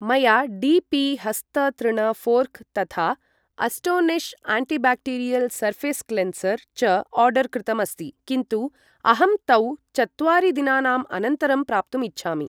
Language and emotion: Sanskrit, neutral